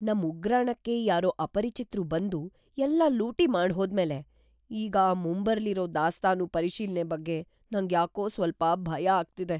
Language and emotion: Kannada, fearful